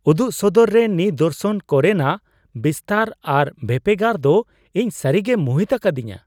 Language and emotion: Santali, surprised